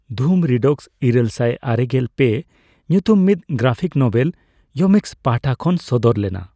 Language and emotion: Santali, neutral